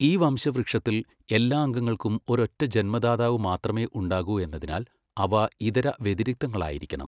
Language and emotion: Malayalam, neutral